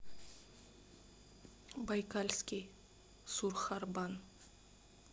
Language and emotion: Russian, neutral